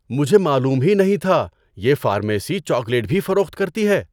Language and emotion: Urdu, surprised